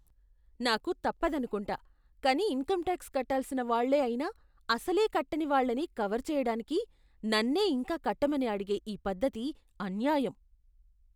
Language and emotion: Telugu, disgusted